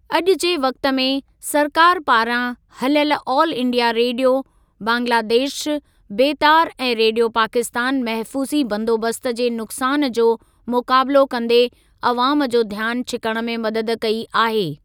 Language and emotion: Sindhi, neutral